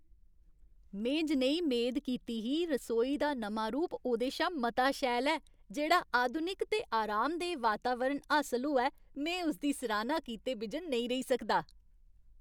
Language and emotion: Dogri, happy